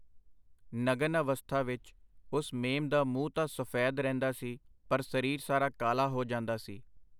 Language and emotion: Punjabi, neutral